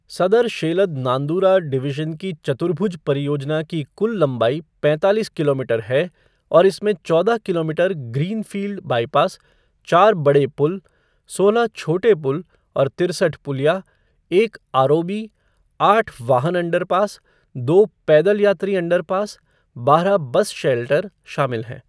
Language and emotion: Hindi, neutral